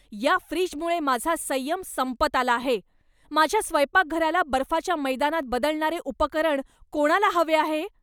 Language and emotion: Marathi, angry